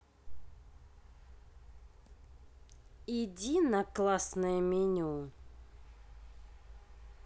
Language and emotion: Russian, neutral